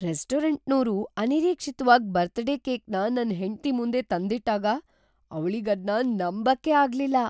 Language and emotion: Kannada, surprised